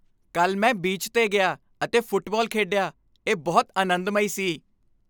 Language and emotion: Punjabi, happy